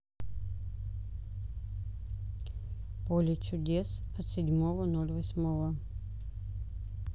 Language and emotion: Russian, neutral